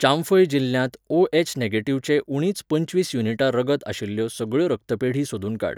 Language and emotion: Goan Konkani, neutral